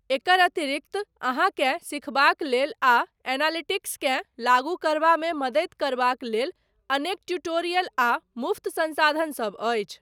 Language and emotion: Maithili, neutral